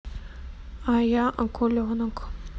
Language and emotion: Russian, neutral